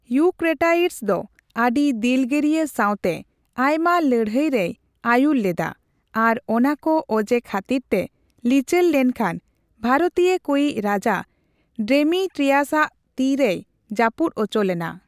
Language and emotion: Santali, neutral